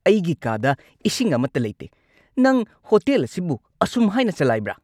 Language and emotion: Manipuri, angry